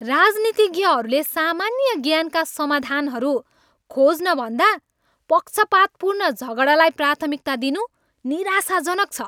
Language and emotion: Nepali, angry